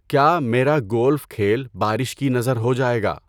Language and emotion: Urdu, neutral